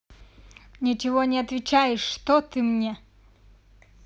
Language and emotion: Russian, angry